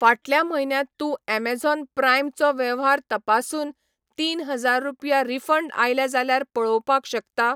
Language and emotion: Goan Konkani, neutral